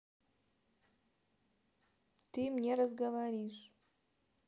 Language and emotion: Russian, neutral